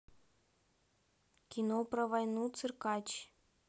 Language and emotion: Russian, neutral